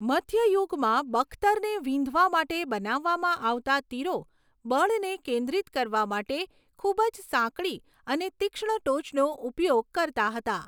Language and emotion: Gujarati, neutral